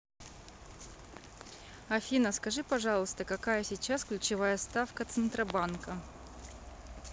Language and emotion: Russian, neutral